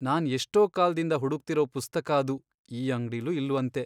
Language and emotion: Kannada, sad